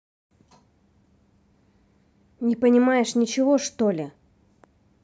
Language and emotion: Russian, angry